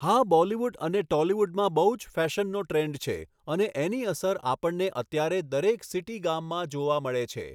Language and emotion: Gujarati, neutral